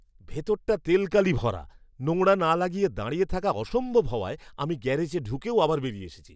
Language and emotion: Bengali, disgusted